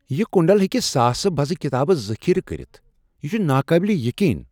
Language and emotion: Kashmiri, surprised